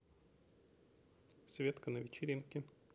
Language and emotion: Russian, neutral